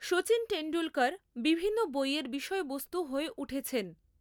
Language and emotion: Bengali, neutral